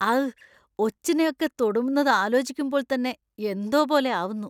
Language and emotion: Malayalam, disgusted